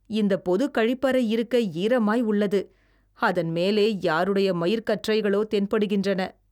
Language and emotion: Tamil, disgusted